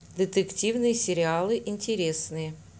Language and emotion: Russian, neutral